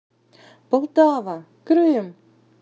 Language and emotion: Russian, positive